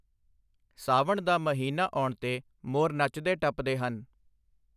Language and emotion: Punjabi, neutral